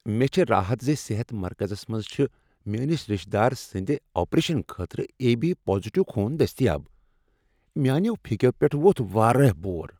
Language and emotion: Kashmiri, happy